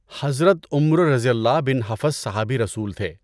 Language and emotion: Urdu, neutral